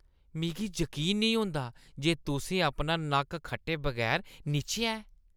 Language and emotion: Dogri, disgusted